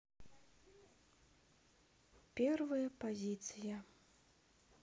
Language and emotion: Russian, sad